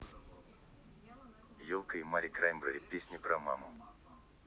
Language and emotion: Russian, neutral